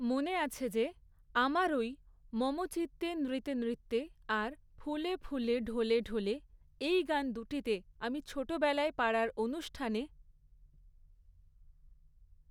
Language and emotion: Bengali, neutral